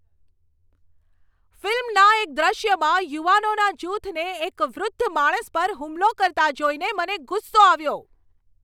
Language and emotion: Gujarati, angry